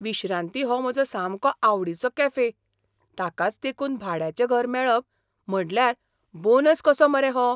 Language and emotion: Goan Konkani, surprised